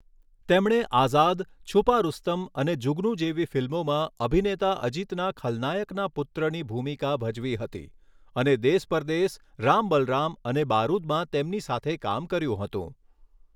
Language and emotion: Gujarati, neutral